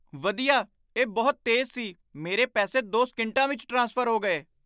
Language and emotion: Punjabi, surprised